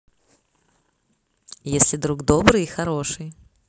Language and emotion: Russian, positive